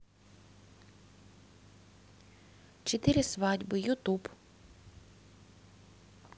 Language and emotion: Russian, neutral